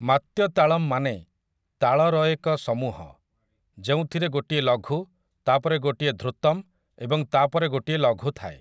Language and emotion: Odia, neutral